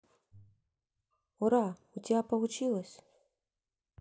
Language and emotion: Russian, neutral